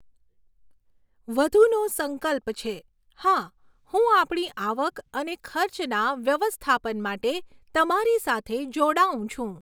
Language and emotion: Gujarati, neutral